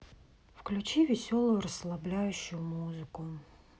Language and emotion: Russian, sad